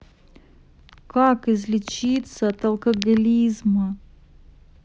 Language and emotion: Russian, sad